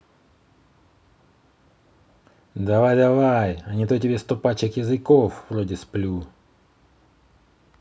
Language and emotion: Russian, angry